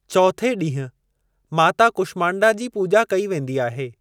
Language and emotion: Sindhi, neutral